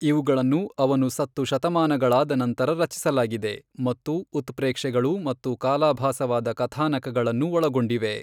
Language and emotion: Kannada, neutral